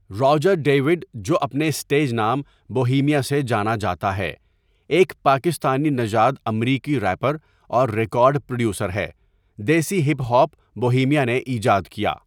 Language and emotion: Urdu, neutral